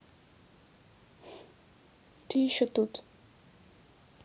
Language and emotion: Russian, neutral